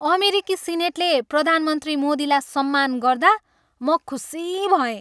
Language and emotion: Nepali, happy